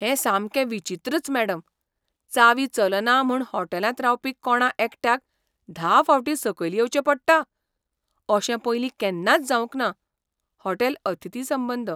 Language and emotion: Goan Konkani, surprised